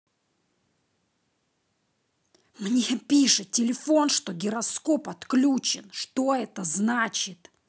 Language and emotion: Russian, angry